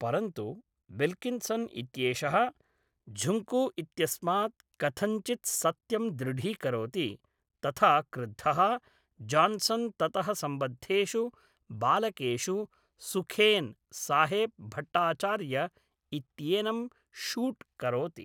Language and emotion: Sanskrit, neutral